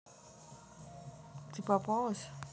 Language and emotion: Russian, neutral